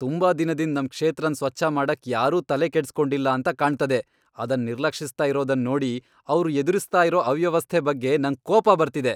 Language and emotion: Kannada, angry